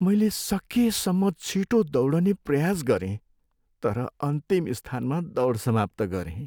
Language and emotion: Nepali, sad